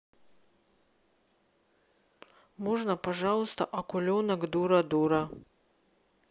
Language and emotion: Russian, neutral